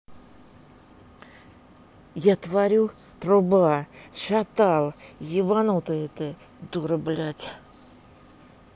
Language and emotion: Russian, neutral